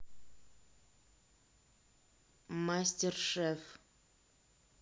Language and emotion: Russian, neutral